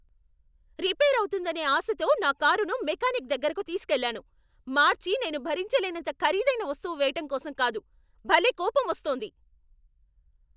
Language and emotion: Telugu, angry